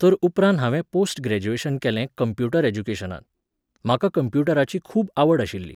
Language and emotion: Goan Konkani, neutral